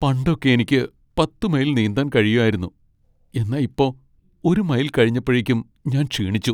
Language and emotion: Malayalam, sad